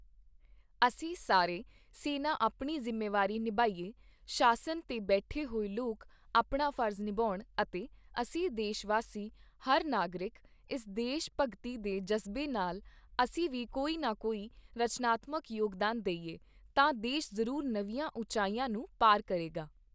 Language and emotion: Punjabi, neutral